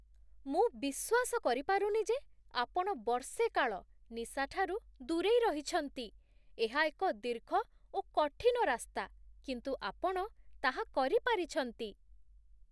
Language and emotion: Odia, surprised